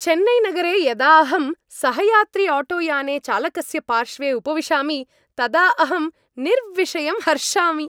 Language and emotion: Sanskrit, happy